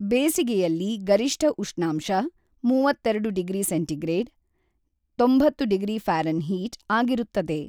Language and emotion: Kannada, neutral